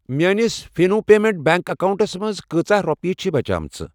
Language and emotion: Kashmiri, neutral